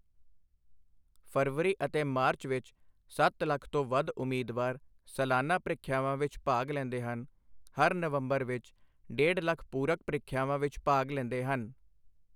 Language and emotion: Punjabi, neutral